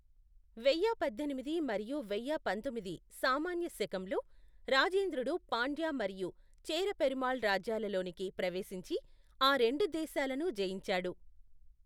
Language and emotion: Telugu, neutral